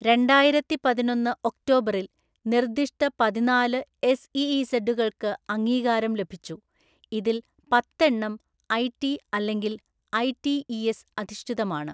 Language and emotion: Malayalam, neutral